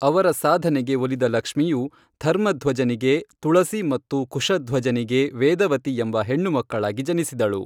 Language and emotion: Kannada, neutral